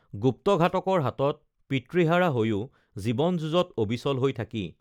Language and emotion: Assamese, neutral